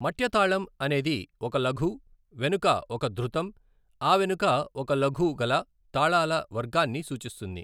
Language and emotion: Telugu, neutral